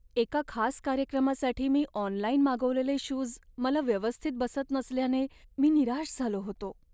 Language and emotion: Marathi, sad